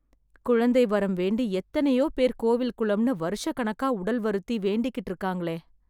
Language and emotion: Tamil, sad